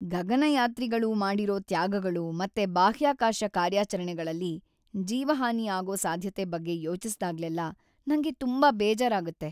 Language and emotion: Kannada, sad